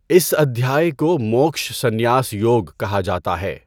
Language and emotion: Urdu, neutral